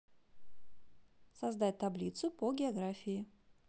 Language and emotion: Russian, positive